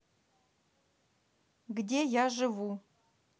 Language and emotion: Russian, neutral